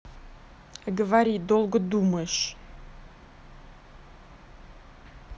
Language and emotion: Russian, angry